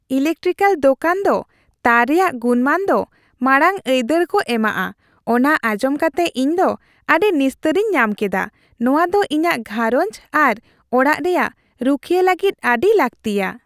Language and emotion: Santali, happy